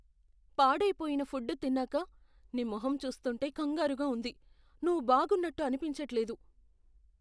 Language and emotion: Telugu, fearful